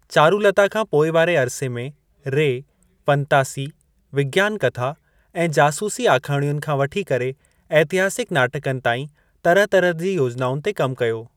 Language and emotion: Sindhi, neutral